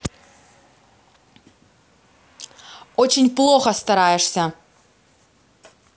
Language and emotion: Russian, angry